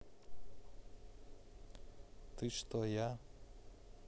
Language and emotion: Russian, neutral